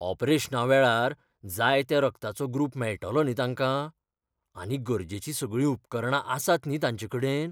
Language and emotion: Goan Konkani, fearful